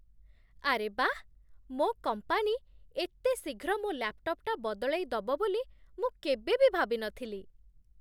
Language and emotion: Odia, surprised